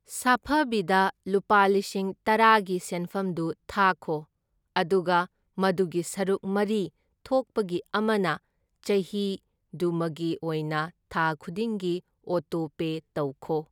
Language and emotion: Manipuri, neutral